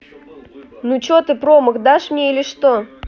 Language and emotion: Russian, neutral